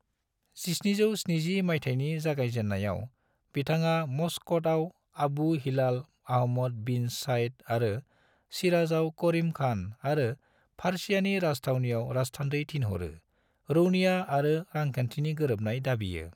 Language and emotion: Bodo, neutral